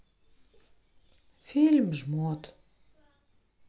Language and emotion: Russian, sad